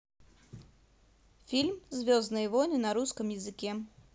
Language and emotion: Russian, positive